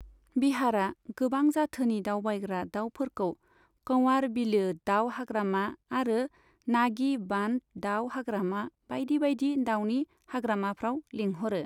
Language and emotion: Bodo, neutral